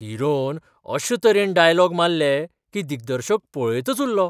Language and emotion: Goan Konkani, surprised